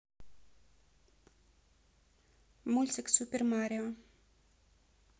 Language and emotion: Russian, neutral